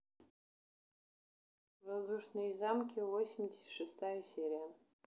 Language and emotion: Russian, neutral